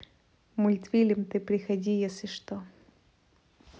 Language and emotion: Russian, neutral